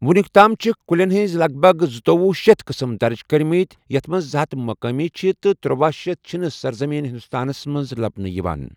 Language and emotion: Kashmiri, neutral